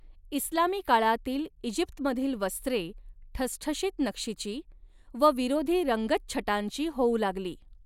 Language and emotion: Marathi, neutral